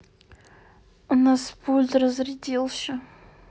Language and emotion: Russian, sad